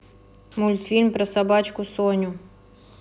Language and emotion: Russian, neutral